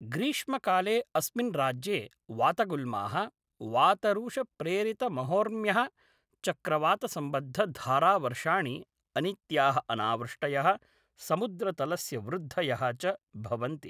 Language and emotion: Sanskrit, neutral